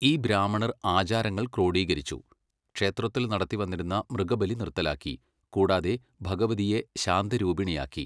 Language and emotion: Malayalam, neutral